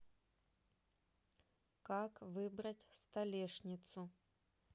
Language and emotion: Russian, neutral